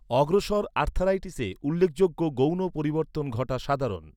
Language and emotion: Bengali, neutral